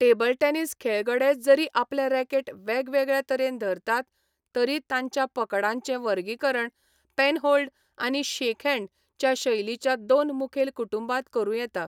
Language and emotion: Goan Konkani, neutral